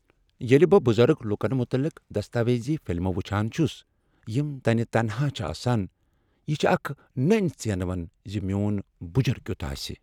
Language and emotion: Kashmiri, sad